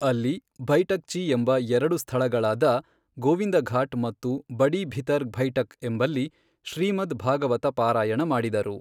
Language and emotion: Kannada, neutral